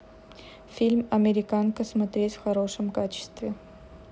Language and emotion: Russian, neutral